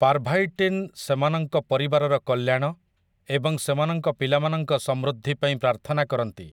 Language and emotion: Odia, neutral